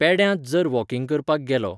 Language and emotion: Goan Konkani, neutral